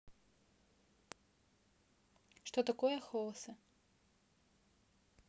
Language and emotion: Russian, neutral